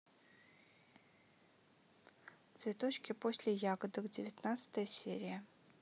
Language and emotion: Russian, neutral